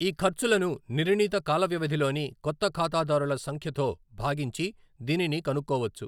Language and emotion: Telugu, neutral